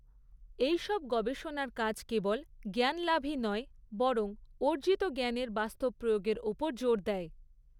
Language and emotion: Bengali, neutral